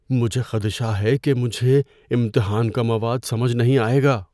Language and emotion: Urdu, fearful